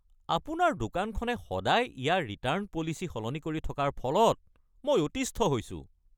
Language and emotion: Assamese, angry